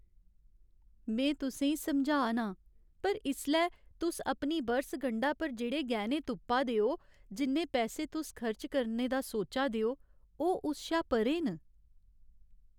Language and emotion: Dogri, sad